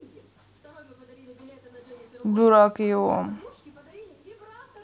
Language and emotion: Russian, neutral